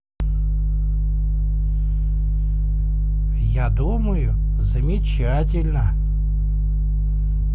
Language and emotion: Russian, positive